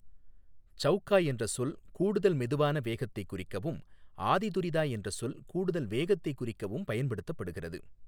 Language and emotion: Tamil, neutral